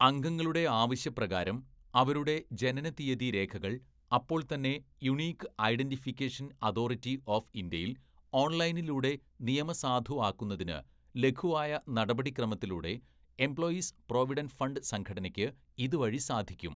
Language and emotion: Malayalam, neutral